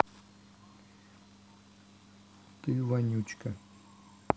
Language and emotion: Russian, neutral